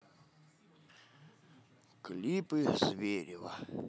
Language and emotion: Russian, positive